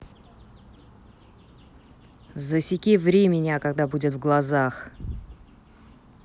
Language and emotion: Russian, angry